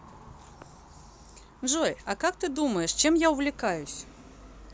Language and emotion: Russian, positive